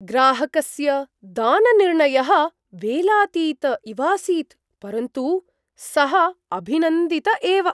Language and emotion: Sanskrit, surprised